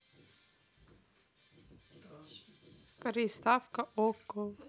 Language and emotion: Russian, neutral